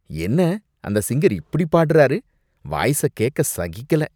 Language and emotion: Tamil, disgusted